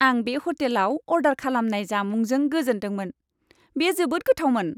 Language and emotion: Bodo, happy